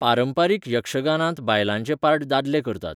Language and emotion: Goan Konkani, neutral